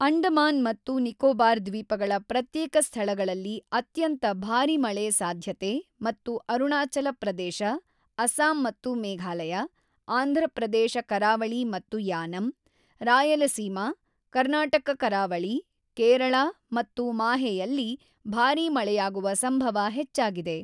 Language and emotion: Kannada, neutral